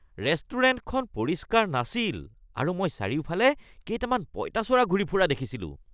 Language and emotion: Assamese, disgusted